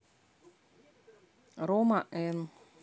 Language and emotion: Russian, neutral